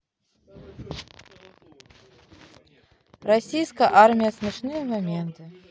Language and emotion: Russian, neutral